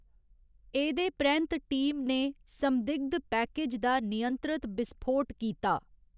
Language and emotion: Dogri, neutral